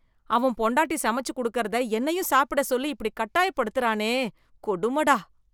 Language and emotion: Tamil, disgusted